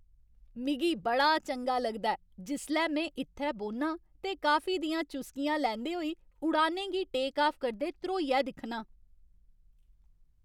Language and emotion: Dogri, happy